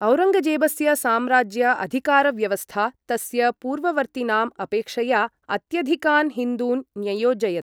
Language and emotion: Sanskrit, neutral